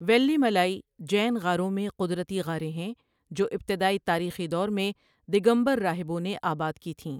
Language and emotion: Urdu, neutral